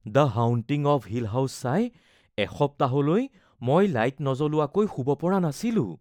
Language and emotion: Assamese, fearful